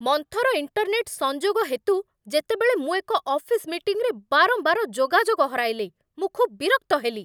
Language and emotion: Odia, angry